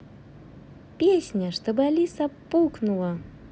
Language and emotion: Russian, positive